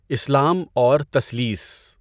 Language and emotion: Urdu, neutral